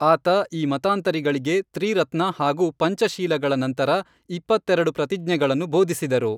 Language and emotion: Kannada, neutral